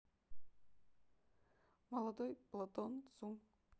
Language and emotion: Russian, neutral